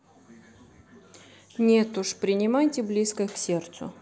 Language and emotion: Russian, neutral